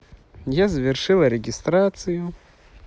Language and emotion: Russian, neutral